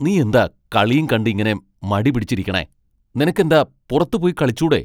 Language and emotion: Malayalam, angry